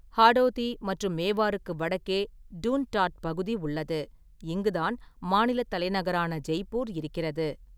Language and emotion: Tamil, neutral